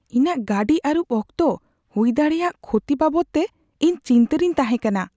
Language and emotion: Santali, fearful